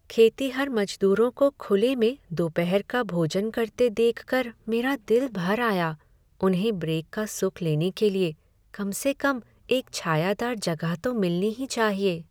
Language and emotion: Hindi, sad